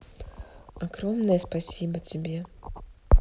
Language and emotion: Russian, neutral